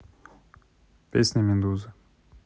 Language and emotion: Russian, neutral